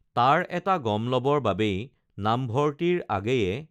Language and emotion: Assamese, neutral